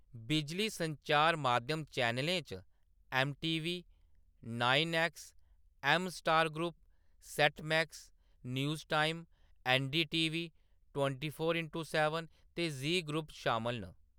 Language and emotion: Dogri, neutral